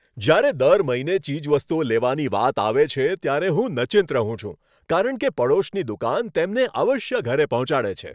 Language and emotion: Gujarati, happy